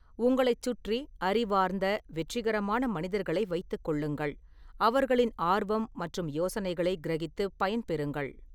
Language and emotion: Tamil, neutral